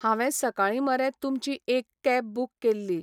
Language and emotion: Goan Konkani, neutral